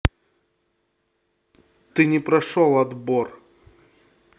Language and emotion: Russian, angry